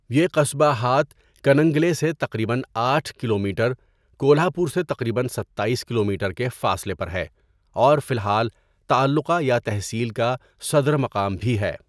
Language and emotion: Urdu, neutral